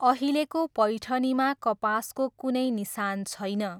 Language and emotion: Nepali, neutral